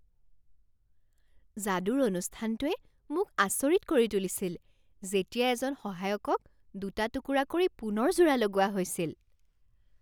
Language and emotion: Assamese, surprised